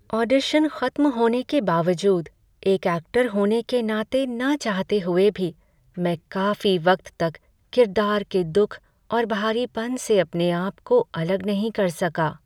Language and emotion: Hindi, sad